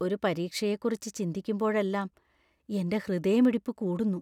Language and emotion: Malayalam, fearful